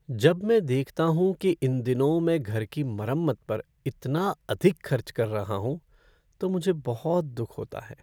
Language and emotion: Hindi, sad